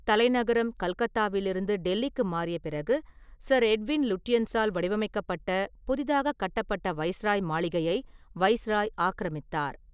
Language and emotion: Tamil, neutral